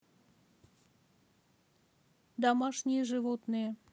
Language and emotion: Russian, neutral